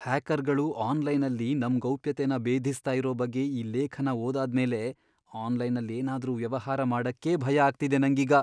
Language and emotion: Kannada, fearful